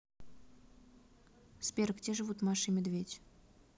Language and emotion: Russian, neutral